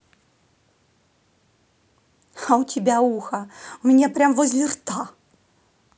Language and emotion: Russian, neutral